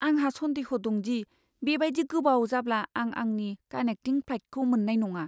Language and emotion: Bodo, fearful